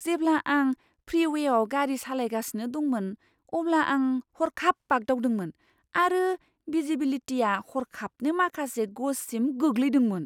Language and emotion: Bodo, surprised